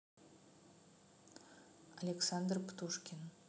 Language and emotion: Russian, neutral